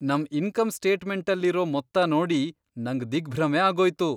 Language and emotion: Kannada, surprised